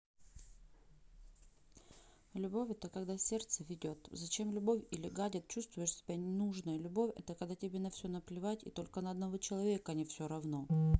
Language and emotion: Russian, neutral